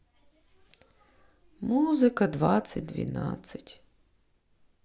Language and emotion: Russian, sad